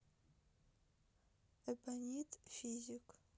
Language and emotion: Russian, sad